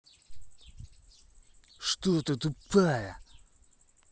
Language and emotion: Russian, angry